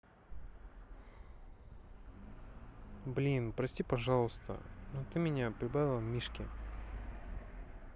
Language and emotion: Russian, sad